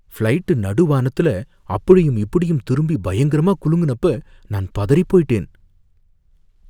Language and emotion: Tamil, fearful